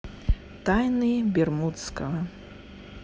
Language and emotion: Russian, neutral